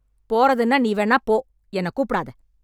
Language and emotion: Tamil, angry